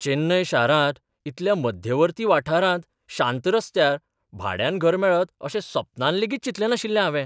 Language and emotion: Goan Konkani, surprised